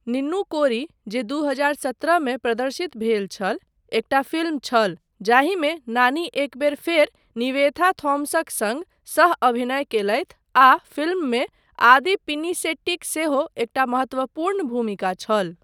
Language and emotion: Maithili, neutral